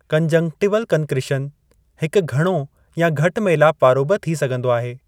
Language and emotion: Sindhi, neutral